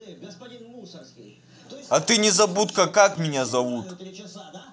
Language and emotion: Russian, angry